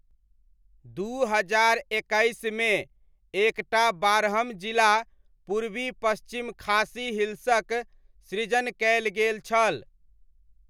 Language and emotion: Maithili, neutral